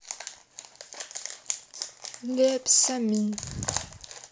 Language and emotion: Russian, neutral